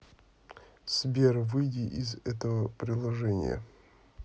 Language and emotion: Russian, neutral